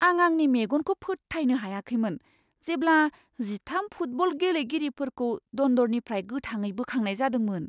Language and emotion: Bodo, surprised